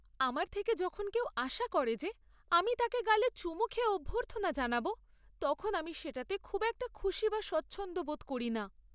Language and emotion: Bengali, sad